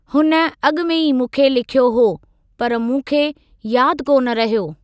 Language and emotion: Sindhi, neutral